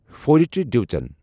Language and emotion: Kashmiri, neutral